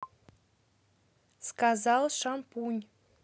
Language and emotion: Russian, neutral